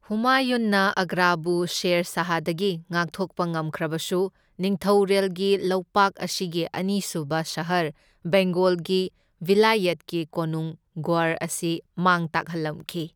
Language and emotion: Manipuri, neutral